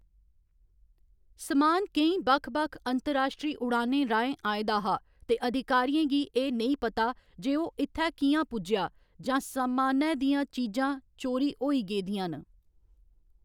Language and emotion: Dogri, neutral